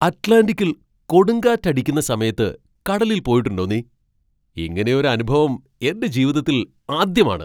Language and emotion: Malayalam, surprised